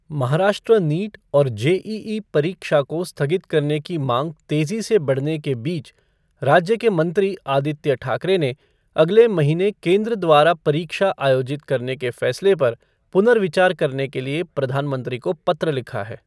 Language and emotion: Hindi, neutral